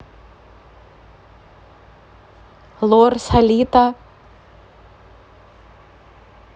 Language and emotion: Russian, neutral